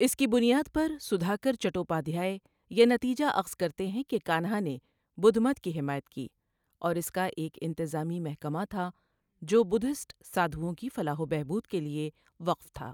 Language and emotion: Urdu, neutral